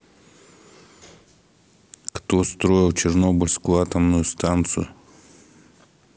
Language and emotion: Russian, neutral